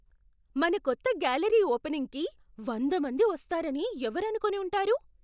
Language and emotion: Telugu, surprised